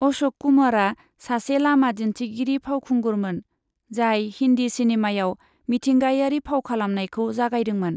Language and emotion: Bodo, neutral